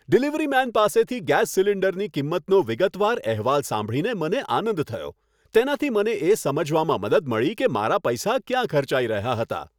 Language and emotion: Gujarati, happy